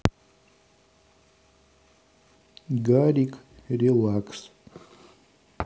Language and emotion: Russian, neutral